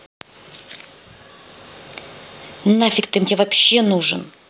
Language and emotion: Russian, angry